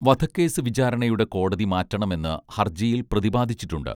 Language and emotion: Malayalam, neutral